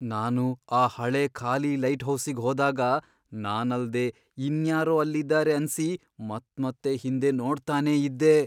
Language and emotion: Kannada, fearful